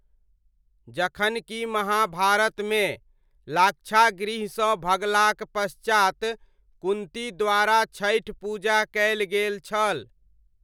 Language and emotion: Maithili, neutral